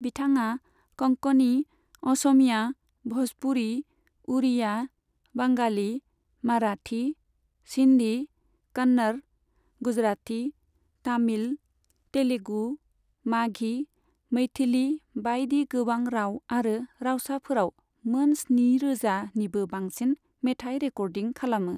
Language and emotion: Bodo, neutral